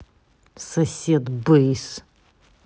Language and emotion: Russian, angry